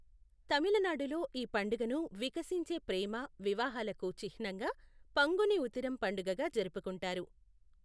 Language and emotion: Telugu, neutral